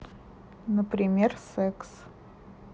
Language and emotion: Russian, neutral